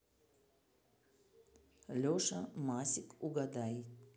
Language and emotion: Russian, neutral